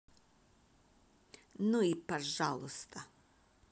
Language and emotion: Russian, angry